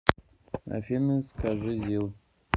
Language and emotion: Russian, neutral